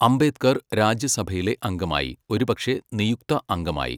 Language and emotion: Malayalam, neutral